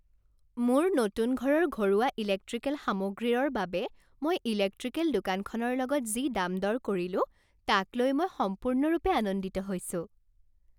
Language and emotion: Assamese, happy